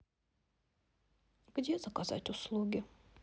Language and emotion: Russian, sad